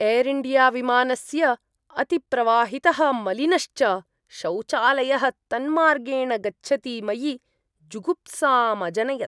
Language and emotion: Sanskrit, disgusted